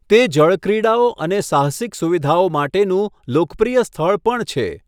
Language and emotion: Gujarati, neutral